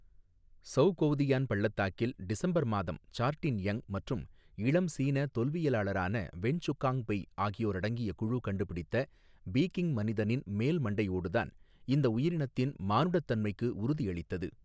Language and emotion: Tamil, neutral